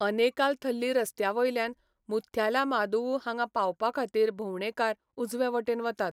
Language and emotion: Goan Konkani, neutral